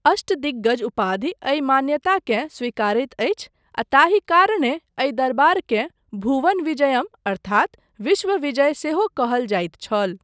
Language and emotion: Maithili, neutral